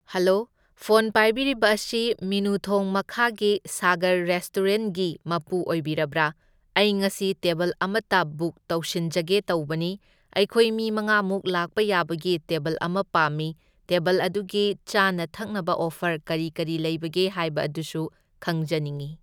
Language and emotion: Manipuri, neutral